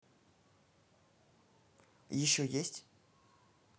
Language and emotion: Russian, neutral